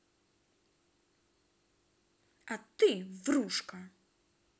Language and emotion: Russian, angry